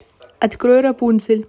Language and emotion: Russian, neutral